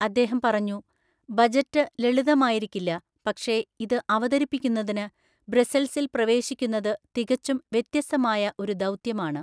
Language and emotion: Malayalam, neutral